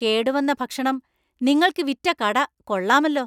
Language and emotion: Malayalam, angry